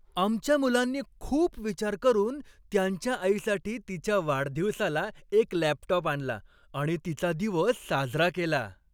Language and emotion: Marathi, happy